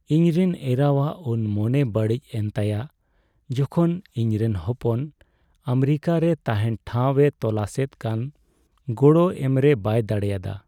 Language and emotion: Santali, sad